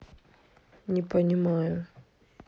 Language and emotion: Russian, sad